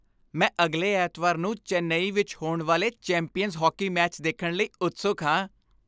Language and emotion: Punjabi, happy